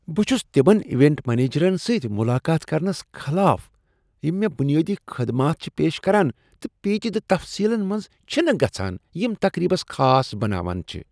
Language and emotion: Kashmiri, disgusted